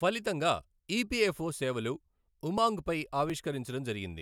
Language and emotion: Telugu, neutral